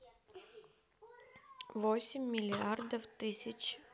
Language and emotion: Russian, neutral